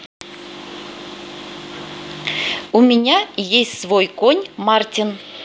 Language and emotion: Russian, neutral